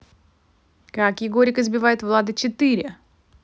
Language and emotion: Russian, positive